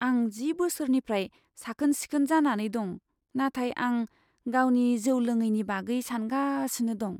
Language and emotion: Bodo, fearful